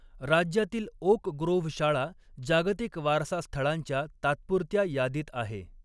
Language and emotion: Marathi, neutral